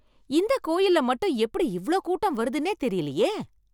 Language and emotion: Tamil, surprised